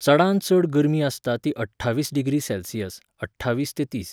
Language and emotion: Goan Konkani, neutral